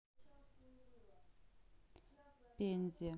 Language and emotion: Russian, neutral